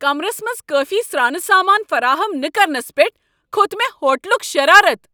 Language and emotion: Kashmiri, angry